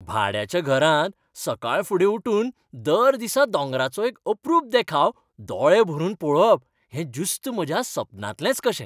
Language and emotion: Goan Konkani, happy